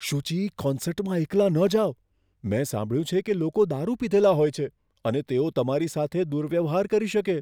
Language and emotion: Gujarati, fearful